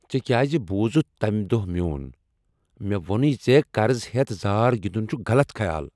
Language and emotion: Kashmiri, angry